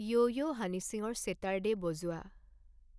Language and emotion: Assamese, neutral